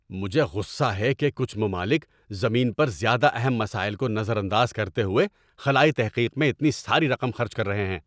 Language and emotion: Urdu, angry